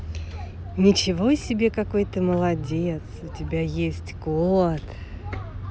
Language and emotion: Russian, positive